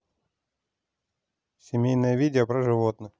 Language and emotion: Russian, neutral